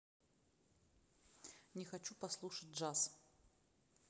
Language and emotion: Russian, neutral